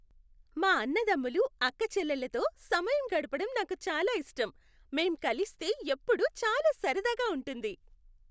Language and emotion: Telugu, happy